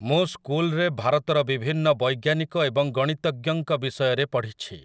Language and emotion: Odia, neutral